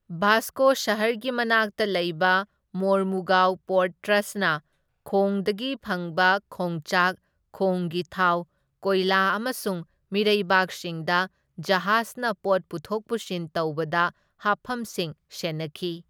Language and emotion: Manipuri, neutral